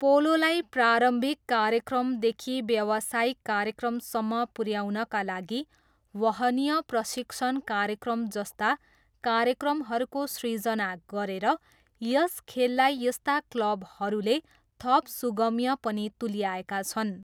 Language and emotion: Nepali, neutral